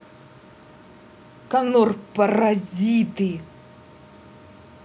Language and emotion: Russian, angry